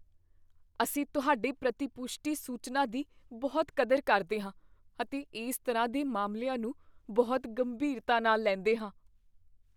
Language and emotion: Punjabi, fearful